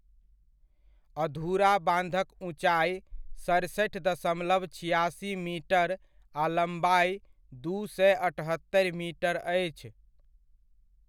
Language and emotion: Maithili, neutral